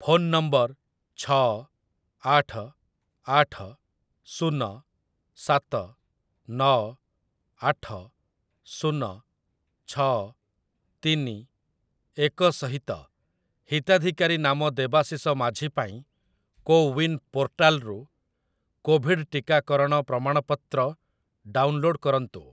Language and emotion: Odia, neutral